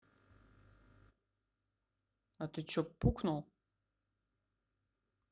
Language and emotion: Russian, neutral